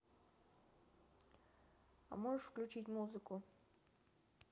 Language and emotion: Russian, neutral